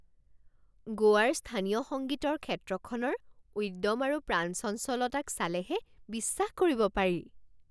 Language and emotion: Assamese, surprised